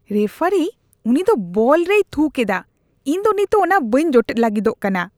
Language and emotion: Santali, disgusted